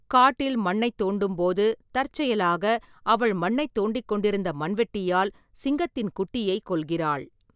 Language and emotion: Tamil, neutral